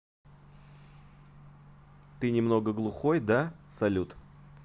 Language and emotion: Russian, neutral